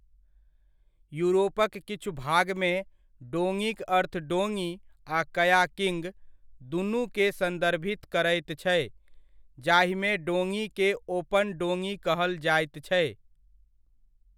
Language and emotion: Maithili, neutral